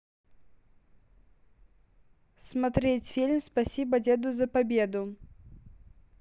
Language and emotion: Russian, neutral